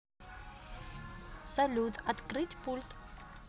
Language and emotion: Russian, positive